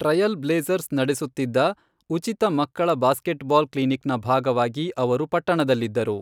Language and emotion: Kannada, neutral